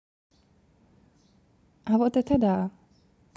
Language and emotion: Russian, neutral